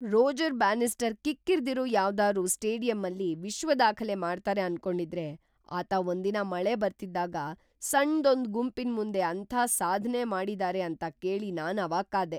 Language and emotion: Kannada, surprised